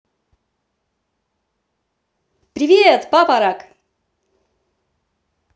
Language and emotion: Russian, positive